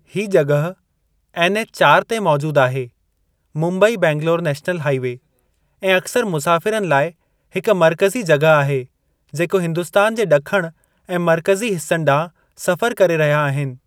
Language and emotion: Sindhi, neutral